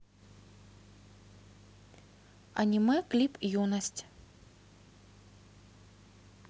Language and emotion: Russian, neutral